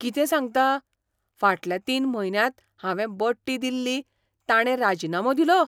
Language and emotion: Goan Konkani, surprised